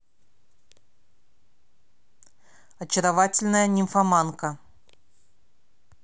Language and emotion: Russian, neutral